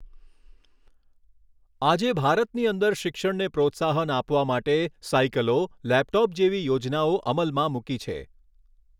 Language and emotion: Gujarati, neutral